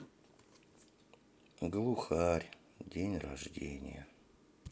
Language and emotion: Russian, sad